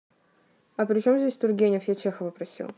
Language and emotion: Russian, neutral